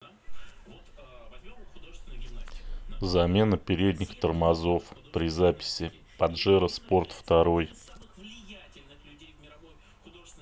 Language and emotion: Russian, neutral